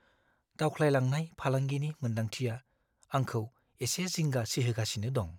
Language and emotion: Bodo, fearful